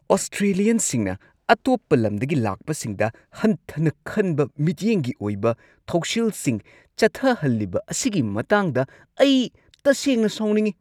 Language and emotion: Manipuri, angry